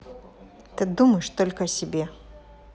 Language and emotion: Russian, angry